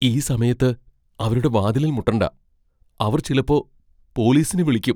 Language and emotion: Malayalam, fearful